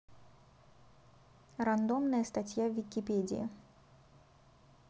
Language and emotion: Russian, neutral